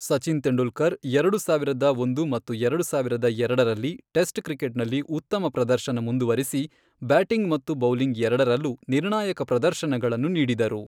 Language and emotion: Kannada, neutral